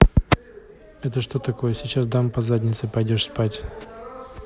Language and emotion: Russian, neutral